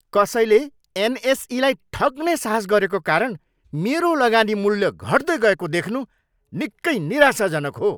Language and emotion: Nepali, angry